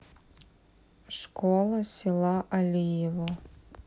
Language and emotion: Russian, neutral